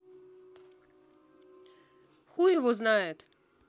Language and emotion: Russian, neutral